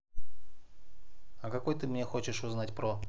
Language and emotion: Russian, neutral